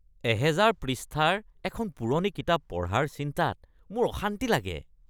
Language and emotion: Assamese, disgusted